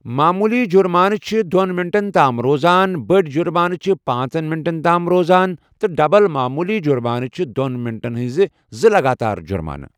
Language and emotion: Kashmiri, neutral